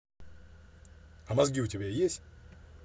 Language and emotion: Russian, angry